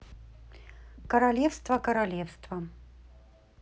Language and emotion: Russian, neutral